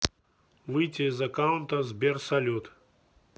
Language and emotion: Russian, neutral